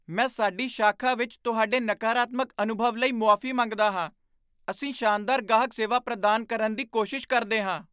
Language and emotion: Punjabi, surprised